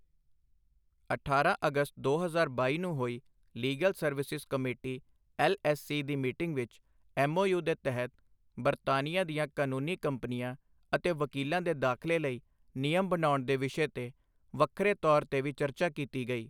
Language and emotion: Punjabi, neutral